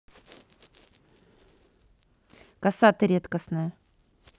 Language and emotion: Russian, neutral